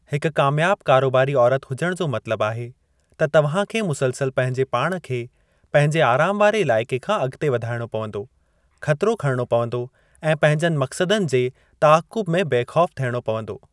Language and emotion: Sindhi, neutral